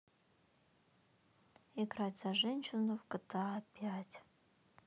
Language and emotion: Russian, neutral